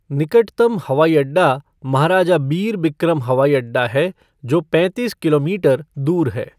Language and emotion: Hindi, neutral